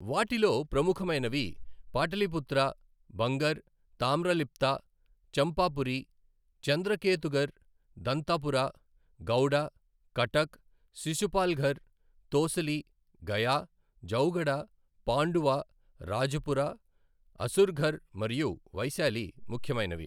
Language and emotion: Telugu, neutral